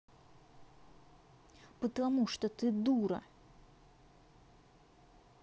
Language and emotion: Russian, angry